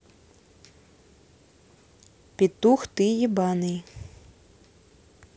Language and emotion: Russian, neutral